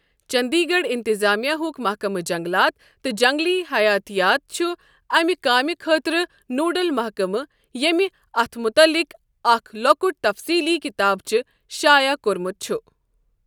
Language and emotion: Kashmiri, neutral